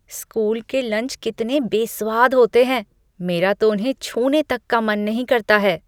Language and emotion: Hindi, disgusted